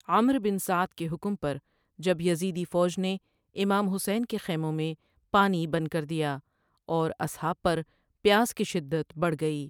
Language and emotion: Urdu, neutral